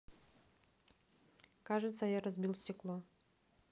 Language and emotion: Russian, neutral